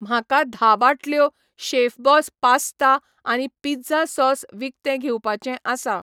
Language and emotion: Goan Konkani, neutral